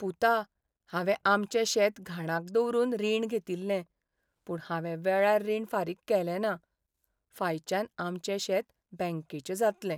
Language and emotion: Goan Konkani, sad